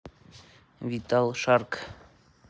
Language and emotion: Russian, neutral